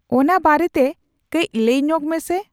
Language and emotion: Santali, neutral